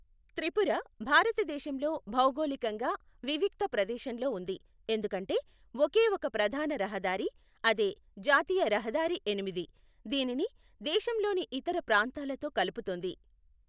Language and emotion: Telugu, neutral